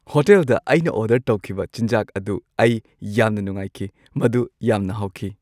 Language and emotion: Manipuri, happy